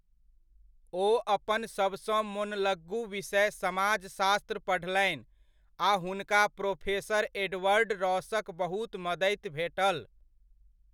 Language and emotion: Maithili, neutral